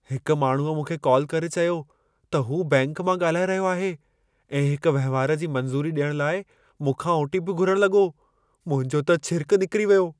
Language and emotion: Sindhi, fearful